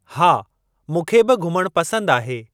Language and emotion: Sindhi, neutral